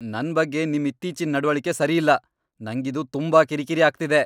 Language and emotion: Kannada, angry